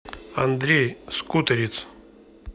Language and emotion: Russian, neutral